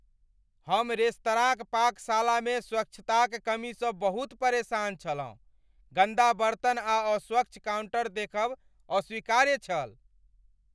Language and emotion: Maithili, angry